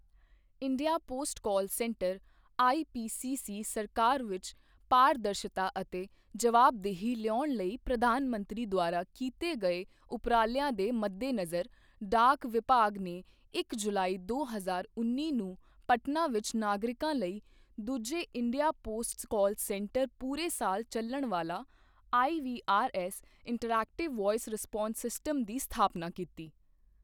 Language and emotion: Punjabi, neutral